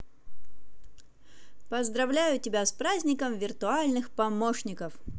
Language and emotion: Russian, positive